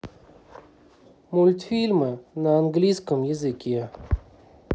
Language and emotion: Russian, neutral